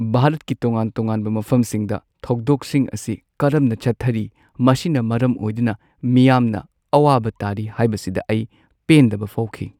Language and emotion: Manipuri, sad